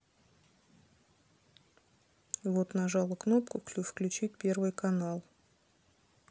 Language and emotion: Russian, neutral